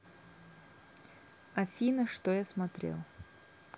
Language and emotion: Russian, neutral